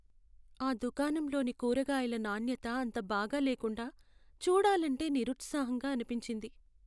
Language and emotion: Telugu, sad